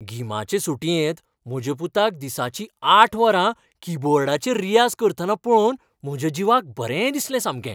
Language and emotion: Goan Konkani, happy